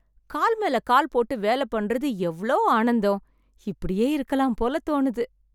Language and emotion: Tamil, happy